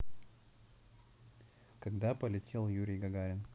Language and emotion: Russian, neutral